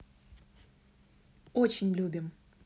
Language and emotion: Russian, positive